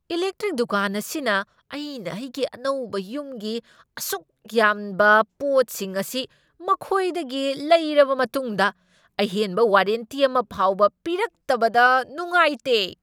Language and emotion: Manipuri, angry